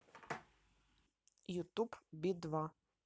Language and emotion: Russian, neutral